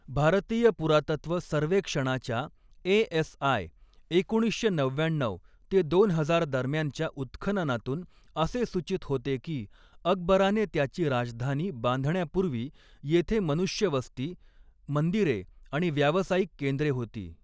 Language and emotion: Marathi, neutral